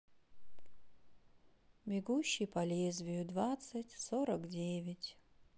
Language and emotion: Russian, sad